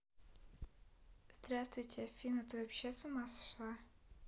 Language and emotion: Russian, neutral